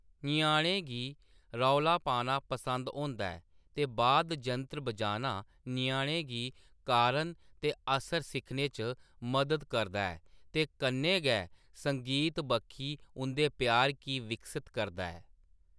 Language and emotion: Dogri, neutral